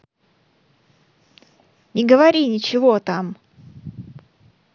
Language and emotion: Russian, angry